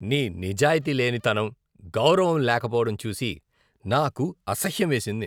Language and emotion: Telugu, disgusted